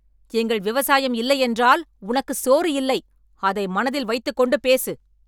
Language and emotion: Tamil, angry